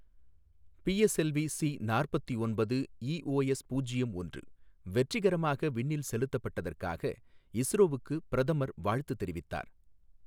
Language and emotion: Tamil, neutral